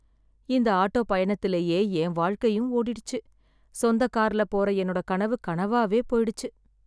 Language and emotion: Tamil, sad